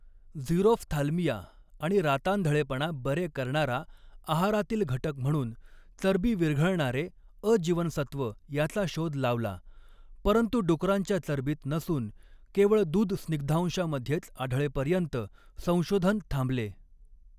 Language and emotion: Marathi, neutral